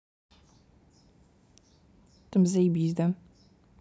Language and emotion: Russian, neutral